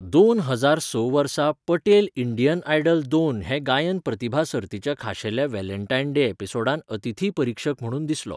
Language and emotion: Goan Konkani, neutral